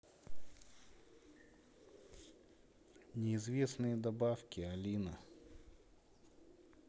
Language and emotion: Russian, neutral